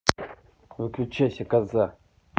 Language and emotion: Russian, angry